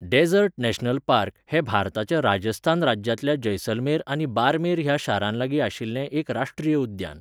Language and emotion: Goan Konkani, neutral